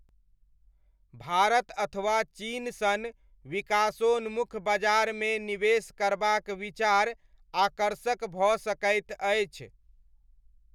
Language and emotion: Maithili, neutral